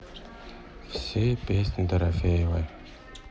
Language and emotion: Russian, sad